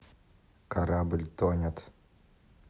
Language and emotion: Russian, neutral